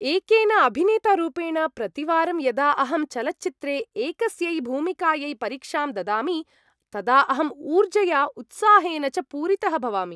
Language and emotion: Sanskrit, happy